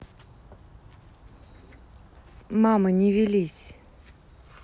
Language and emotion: Russian, neutral